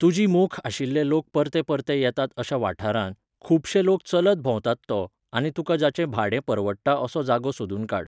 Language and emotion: Goan Konkani, neutral